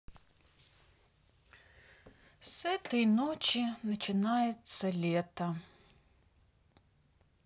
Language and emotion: Russian, sad